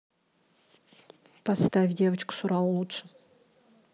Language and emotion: Russian, neutral